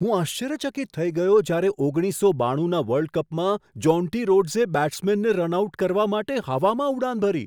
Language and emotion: Gujarati, surprised